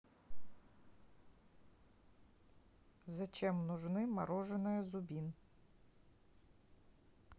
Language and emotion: Russian, neutral